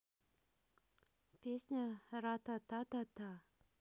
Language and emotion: Russian, neutral